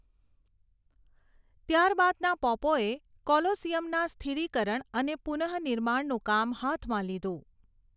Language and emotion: Gujarati, neutral